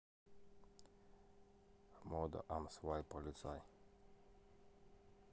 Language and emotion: Russian, neutral